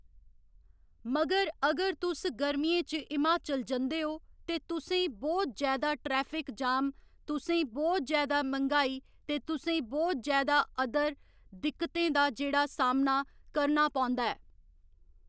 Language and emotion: Dogri, neutral